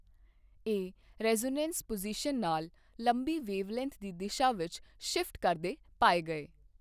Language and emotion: Punjabi, neutral